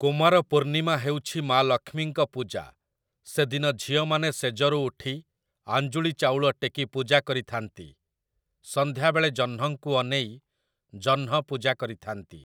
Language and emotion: Odia, neutral